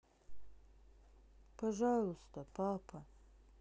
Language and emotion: Russian, sad